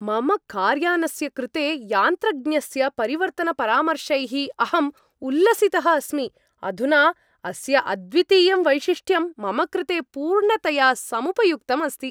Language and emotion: Sanskrit, happy